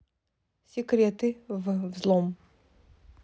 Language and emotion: Russian, neutral